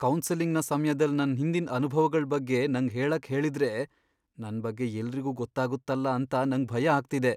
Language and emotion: Kannada, fearful